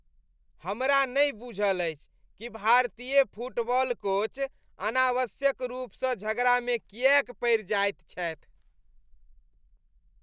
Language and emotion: Maithili, disgusted